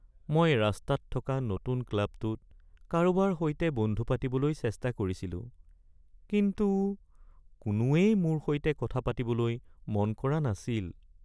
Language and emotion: Assamese, sad